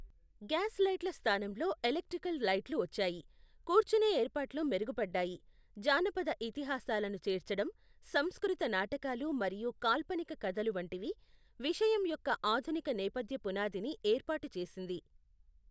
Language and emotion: Telugu, neutral